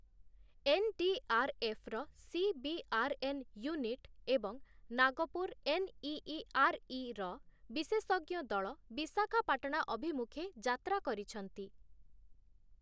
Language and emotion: Odia, neutral